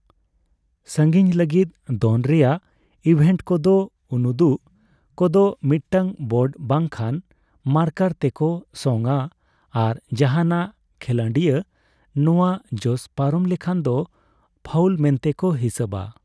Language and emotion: Santali, neutral